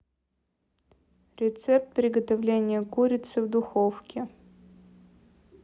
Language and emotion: Russian, neutral